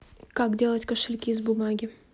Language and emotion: Russian, neutral